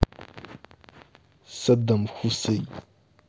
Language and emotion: Russian, angry